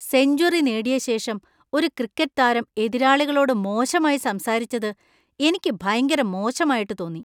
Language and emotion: Malayalam, disgusted